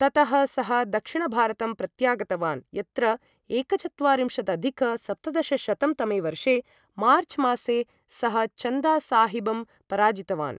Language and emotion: Sanskrit, neutral